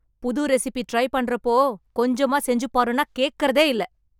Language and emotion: Tamil, angry